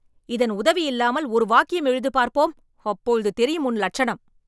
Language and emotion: Tamil, angry